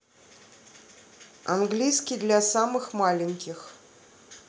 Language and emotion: Russian, neutral